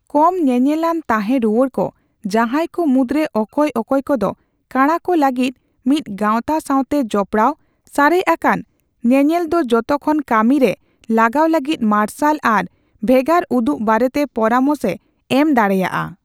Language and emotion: Santali, neutral